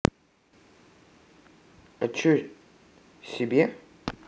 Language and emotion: Russian, neutral